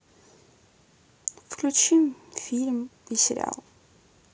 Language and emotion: Russian, sad